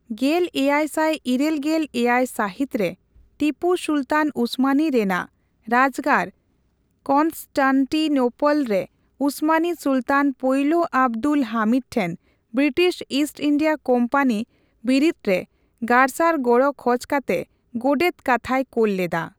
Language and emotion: Santali, neutral